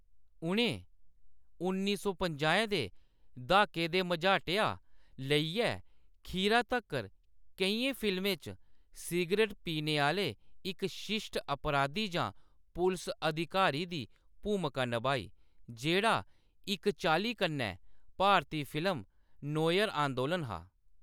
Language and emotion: Dogri, neutral